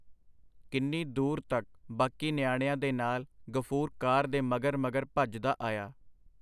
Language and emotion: Punjabi, neutral